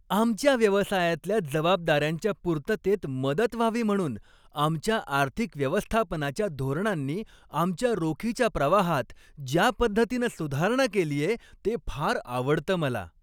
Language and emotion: Marathi, happy